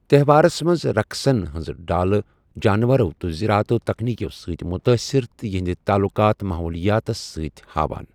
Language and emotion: Kashmiri, neutral